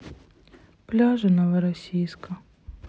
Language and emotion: Russian, sad